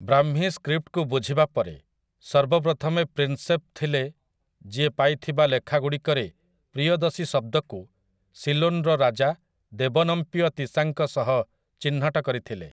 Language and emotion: Odia, neutral